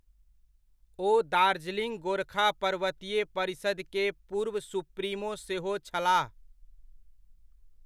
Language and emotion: Maithili, neutral